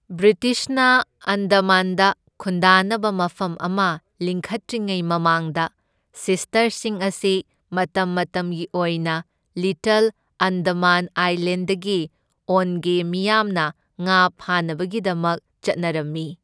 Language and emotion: Manipuri, neutral